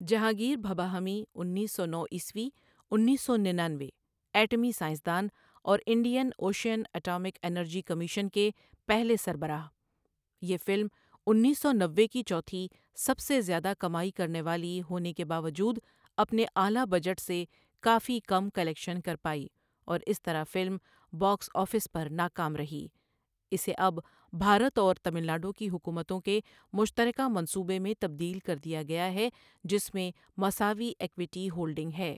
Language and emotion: Urdu, neutral